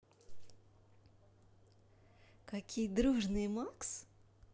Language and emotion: Russian, positive